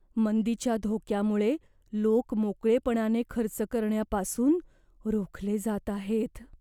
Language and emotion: Marathi, fearful